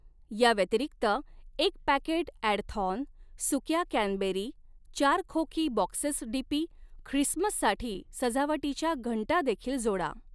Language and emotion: Marathi, neutral